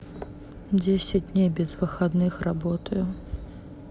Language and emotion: Russian, neutral